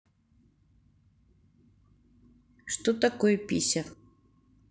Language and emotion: Russian, neutral